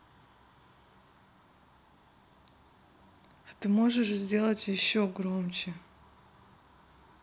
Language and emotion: Russian, neutral